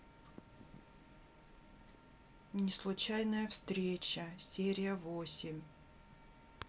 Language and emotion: Russian, neutral